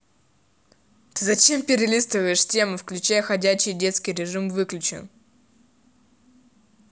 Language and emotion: Russian, angry